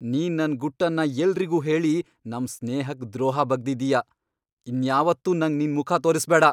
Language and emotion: Kannada, angry